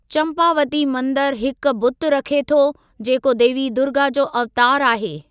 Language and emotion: Sindhi, neutral